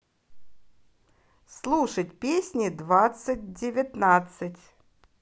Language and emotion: Russian, positive